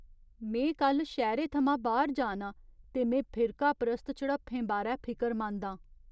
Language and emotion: Dogri, fearful